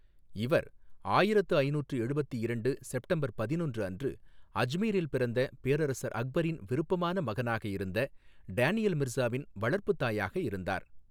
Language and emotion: Tamil, neutral